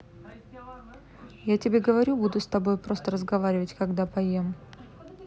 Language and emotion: Russian, neutral